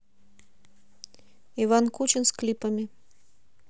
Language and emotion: Russian, neutral